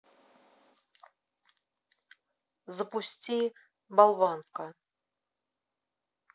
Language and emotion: Russian, neutral